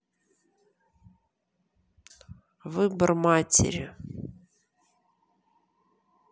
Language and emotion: Russian, neutral